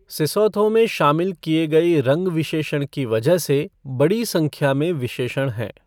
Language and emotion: Hindi, neutral